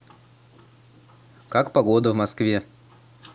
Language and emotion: Russian, neutral